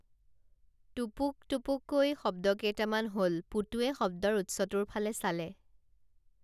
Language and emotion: Assamese, neutral